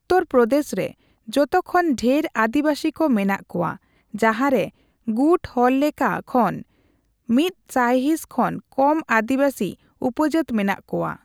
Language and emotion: Santali, neutral